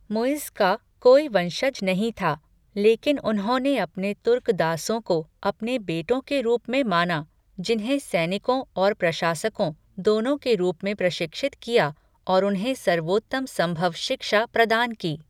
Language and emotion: Hindi, neutral